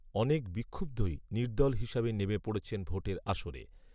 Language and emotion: Bengali, neutral